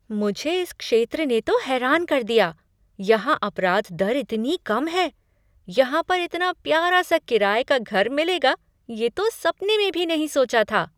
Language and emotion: Hindi, surprised